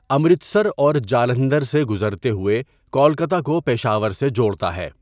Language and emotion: Urdu, neutral